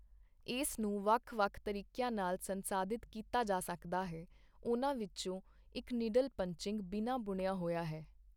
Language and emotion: Punjabi, neutral